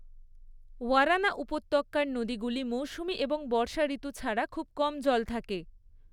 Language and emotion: Bengali, neutral